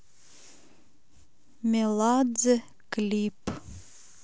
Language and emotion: Russian, neutral